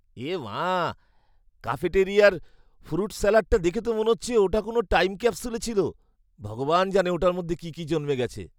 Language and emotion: Bengali, disgusted